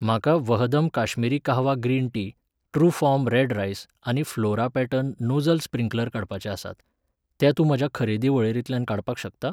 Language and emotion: Goan Konkani, neutral